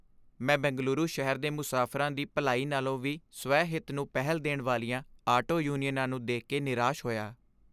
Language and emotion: Punjabi, sad